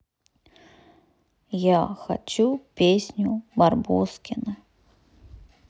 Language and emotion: Russian, neutral